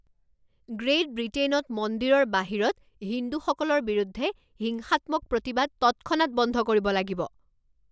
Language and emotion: Assamese, angry